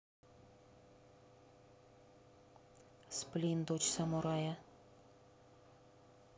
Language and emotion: Russian, neutral